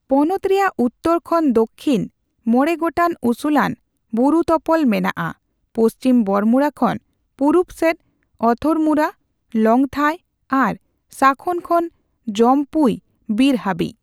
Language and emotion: Santali, neutral